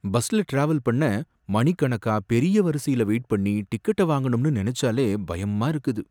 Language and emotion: Tamil, fearful